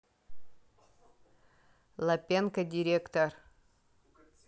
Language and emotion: Russian, neutral